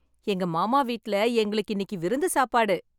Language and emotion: Tamil, happy